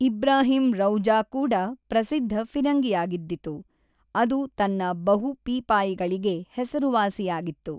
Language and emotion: Kannada, neutral